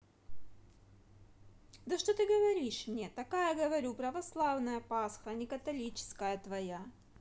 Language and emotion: Russian, angry